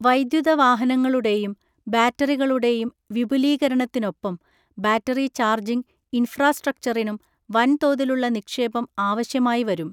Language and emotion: Malayalam, neutral